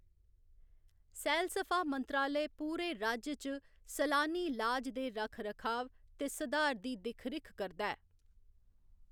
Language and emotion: Dogri, neutral